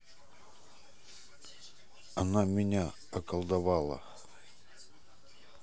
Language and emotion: Russian, neutral